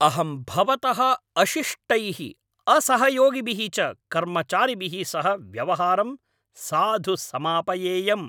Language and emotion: Sanskrit, angry